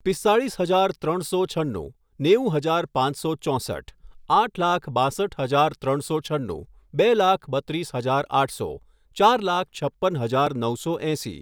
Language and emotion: Gujarati, neutral